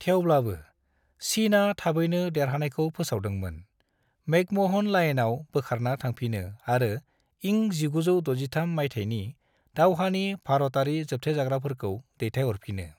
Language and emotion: Bodo, neutral